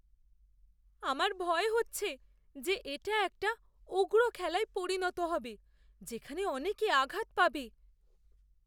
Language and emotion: Bengali, fearful